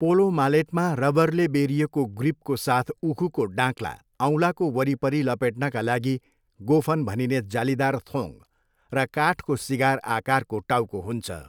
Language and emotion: Nepali, neutral